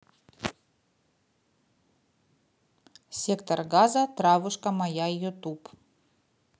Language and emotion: Russian, neutral